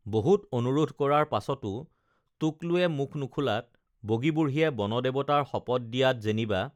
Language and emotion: Assamese, neutral